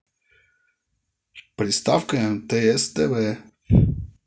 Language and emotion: Russian, positive